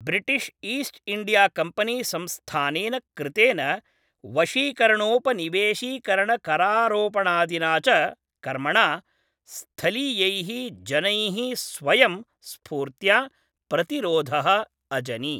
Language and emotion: Sanskrit, neutral